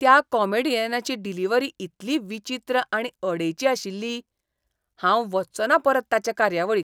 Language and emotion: Goan Konkani, disgusted